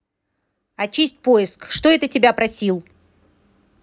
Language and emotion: Russian, angry